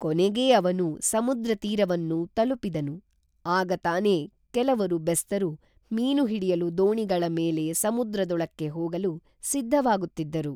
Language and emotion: Kannada, neutral